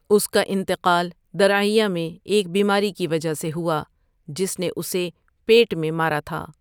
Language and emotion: Urdu, neutral